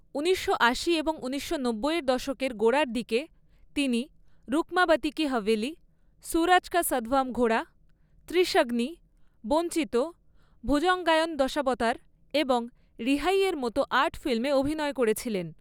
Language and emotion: Bengali, neutral